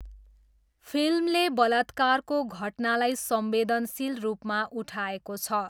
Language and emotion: Nepali, neutral